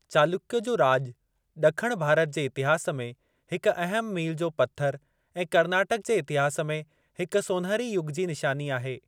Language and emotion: Sindhi, neutral